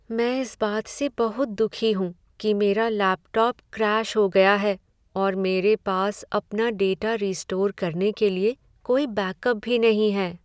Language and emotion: Hindi, sad